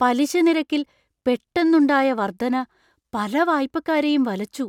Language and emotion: Malayalam, surprised